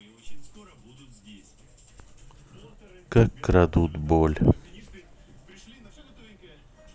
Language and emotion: Russian, sad